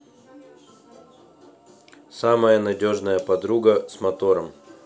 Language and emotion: Russian, neutral